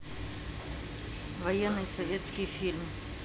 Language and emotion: Russian, neutral